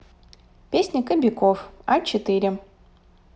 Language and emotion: Russian, neutral